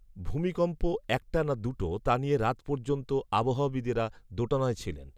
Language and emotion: Bengali, neutral